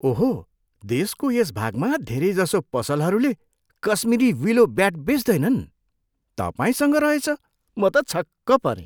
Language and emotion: Nepali, surprised